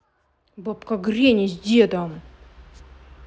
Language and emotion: Russian, angry